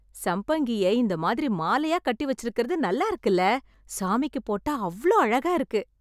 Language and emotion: Tamil, happy